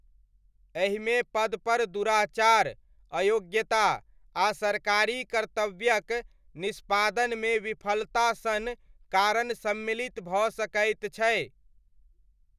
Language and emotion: Maithili, neutral